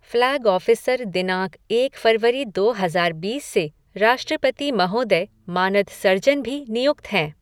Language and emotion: Hindi, neutral